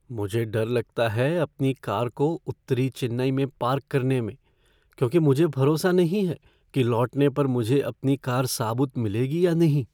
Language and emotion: Hindi, fearful